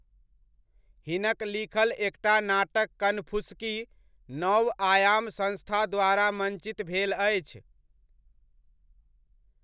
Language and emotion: Maithili, neutral